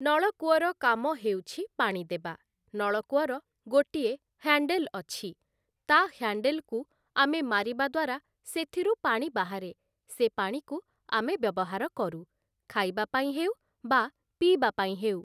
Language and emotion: Odia, neutral